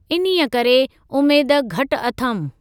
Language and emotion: Sindhi, neutral